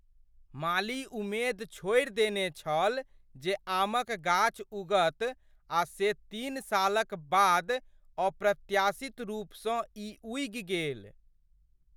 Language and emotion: Maithili, surprised